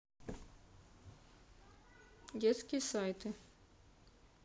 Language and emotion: Russian, neutral